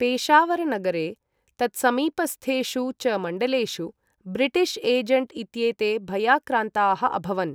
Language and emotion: Sanskrit, neutral